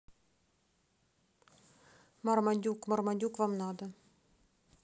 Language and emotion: Russian, neutral